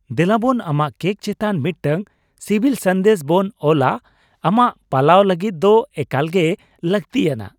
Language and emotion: Santali, happy